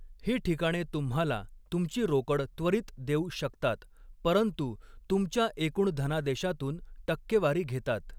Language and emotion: Marathi, neutral